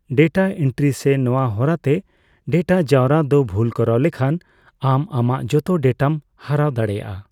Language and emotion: Santali, neutral